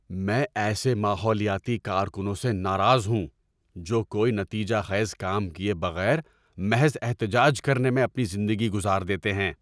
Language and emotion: Urdu, angry